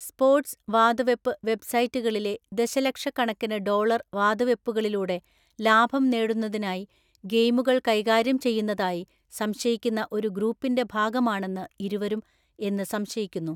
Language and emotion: Malayalam, neutral